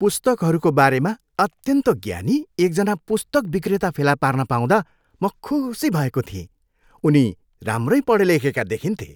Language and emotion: Nepali, happy